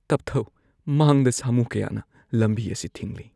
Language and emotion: Manipuri, fearful